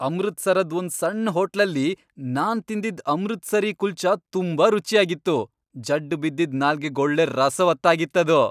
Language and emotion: Kannada, happy